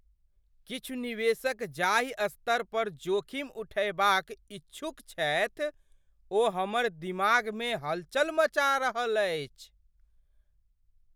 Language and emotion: Maithili, surprised